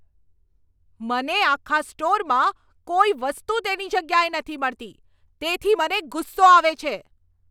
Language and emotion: Gujarati, angry